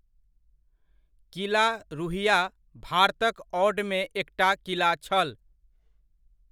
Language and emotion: Maithili, neutral